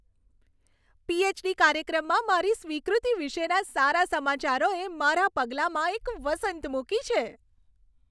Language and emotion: Gujarati, happy